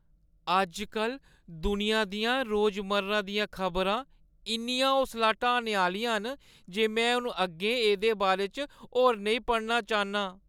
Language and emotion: Dogri, sad